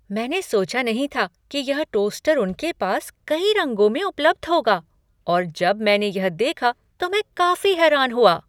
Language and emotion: Hindi, surprised